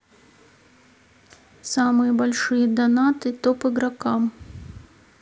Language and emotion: Russian, neutral